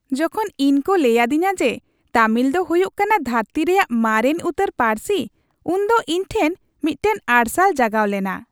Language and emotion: Santali, happy